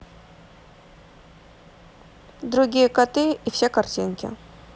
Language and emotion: Russian, neutral